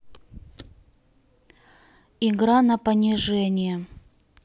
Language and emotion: Russian, neutral